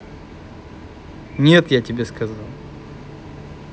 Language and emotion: Russian, angry